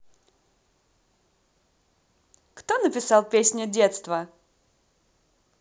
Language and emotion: Russian, positive